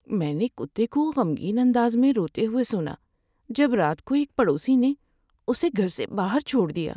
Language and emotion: Urdu, sad